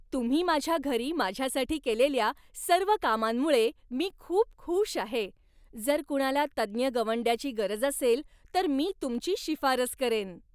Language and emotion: Marathi, happy